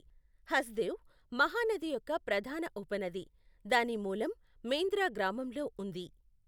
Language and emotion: Telugu, neutral